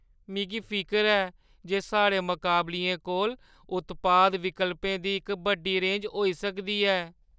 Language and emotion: Dogri, fearful